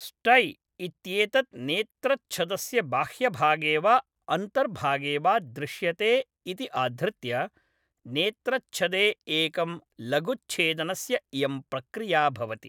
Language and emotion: Sanskrit, neutral